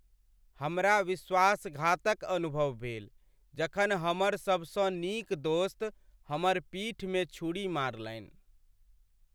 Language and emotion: Maithili, sad